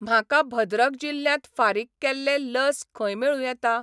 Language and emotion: Goan Konkani, neutral